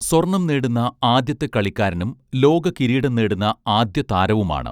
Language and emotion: Malayalam, neutral